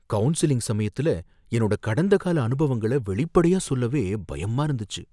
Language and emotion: Tamil, fearful